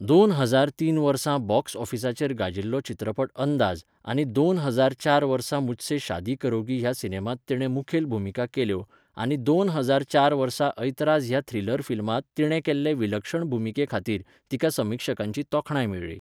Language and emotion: Goan Konkani, neutral